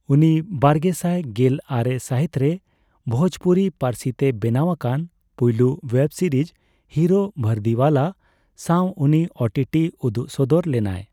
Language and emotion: Santali, neutral